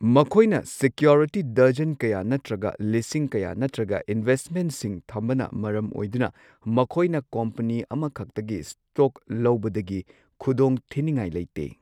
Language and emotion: Manipuri, neutral